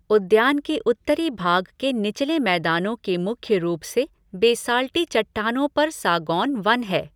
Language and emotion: Hindi, neutral